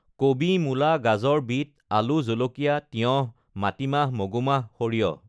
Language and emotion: Assamese, neutral